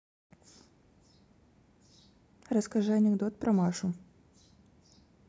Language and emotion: Russian, neutral